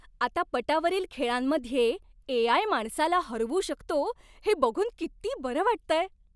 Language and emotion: Marathi, happy